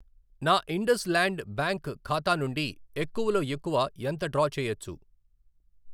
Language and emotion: Telugu, neutral